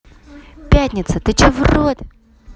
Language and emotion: Russian, angry